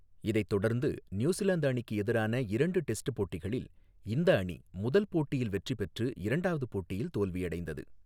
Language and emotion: Tamil, neutral